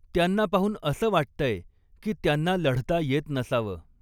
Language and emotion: Marathi, neutral